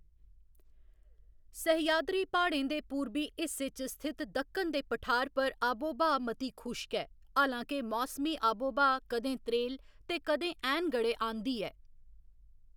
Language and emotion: Dogri, neutral